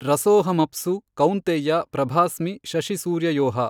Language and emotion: Kannada, neutral